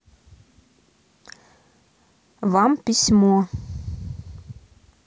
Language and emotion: Russian, neutral